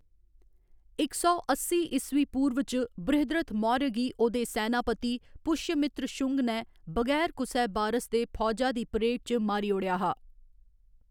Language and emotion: Dogri, neutral